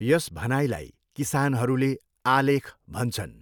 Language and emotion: Nepali, neutral